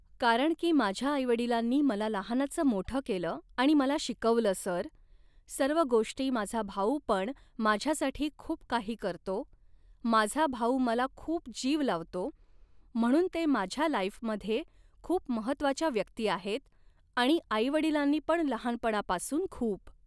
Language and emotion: Marathi, neutral